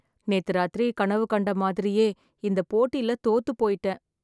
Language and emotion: Tamil, sad